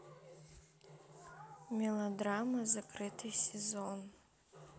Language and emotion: Russian, neutral